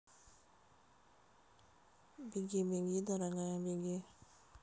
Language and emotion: Russian, neutral